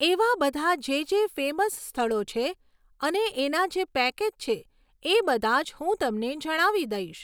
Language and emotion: Gujarati, neutral